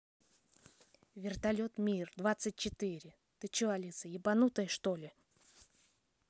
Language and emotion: Russian, neutral